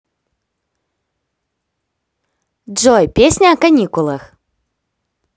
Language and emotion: Russian, positive